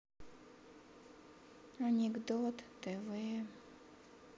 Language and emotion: Russian, sad